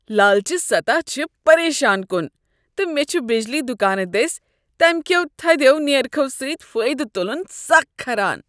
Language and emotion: Kashmiri, disgusted